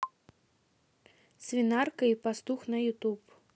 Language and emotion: Russian, neutral